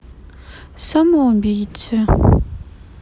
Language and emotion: Russian, sad